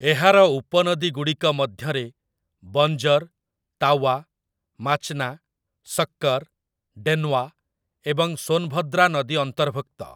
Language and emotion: Odia, neutral